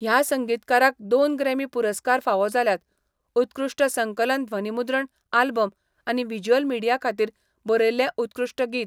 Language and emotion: Goan Konkani, neutral